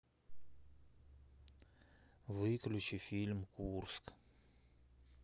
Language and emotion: Russian, sad